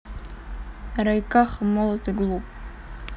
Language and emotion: Russian, neutral